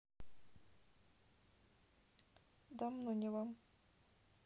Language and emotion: Russian, sad